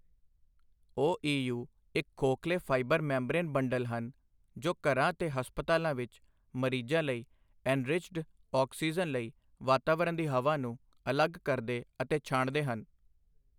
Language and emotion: Punjabi, neutral